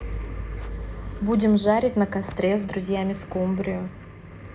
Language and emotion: Russian, neutral